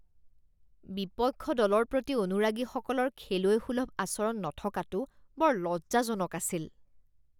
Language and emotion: Assamese, disgusted